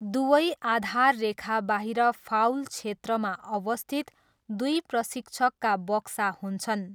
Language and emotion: Nepali, neutral